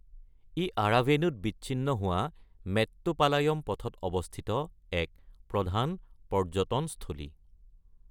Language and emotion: Assamese, neutral